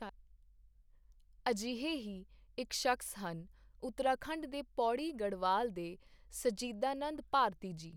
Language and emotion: Punjabi, neutral